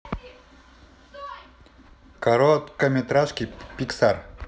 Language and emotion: Russian, neutral